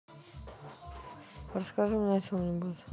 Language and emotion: Russian, neutral